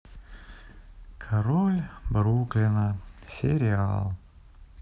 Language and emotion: Russian, sad